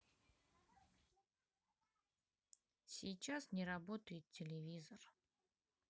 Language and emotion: Russian, sad